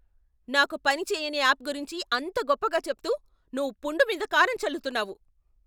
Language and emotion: Telugu, angry